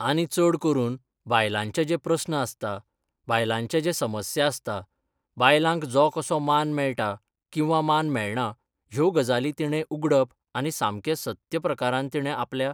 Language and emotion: Goan Konkani, neutral